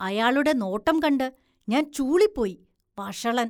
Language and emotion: Malayalam, disgusted